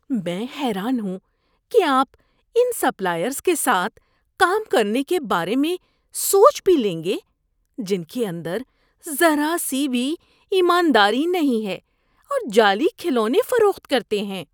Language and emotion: Urdu, disgusted